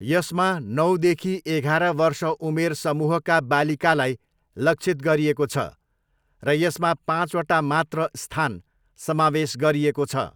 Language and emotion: Nepali, neutral